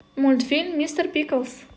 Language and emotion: Russian, positive